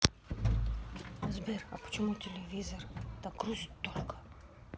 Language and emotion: Russian, neutral